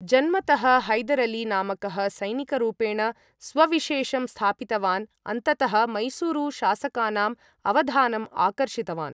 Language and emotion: Sanskrit, neutral